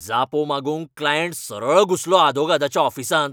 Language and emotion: Goan Konkani, angry